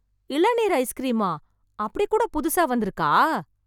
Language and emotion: Tamil, surprised